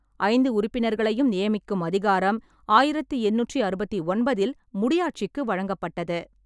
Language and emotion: Tamil, neutral